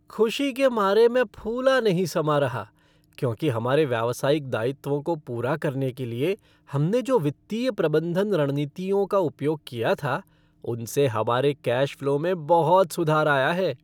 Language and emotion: Hindi, happy